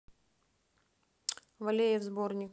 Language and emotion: Russian, neutral